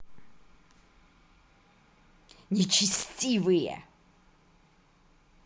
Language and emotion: Russian, angry